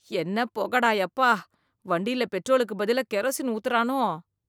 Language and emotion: Tamil, disgusted